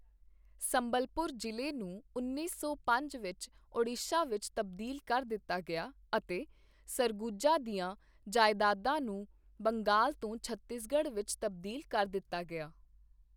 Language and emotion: Punjabi, neutral